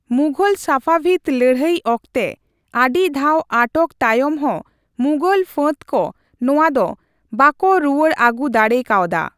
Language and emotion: Santali, neutral